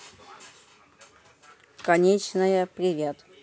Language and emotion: Russian, neutral